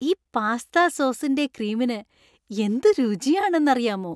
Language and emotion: Malayalam, happy